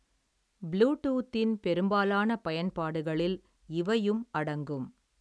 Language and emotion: Tamil, neutral